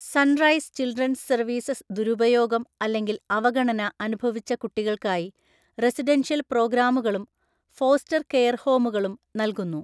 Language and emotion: Malayalam, neutral